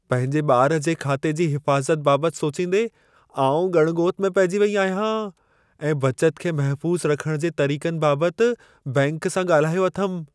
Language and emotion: Sindhi, fearful